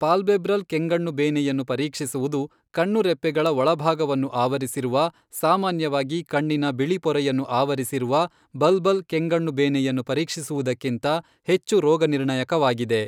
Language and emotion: Kannada, neutral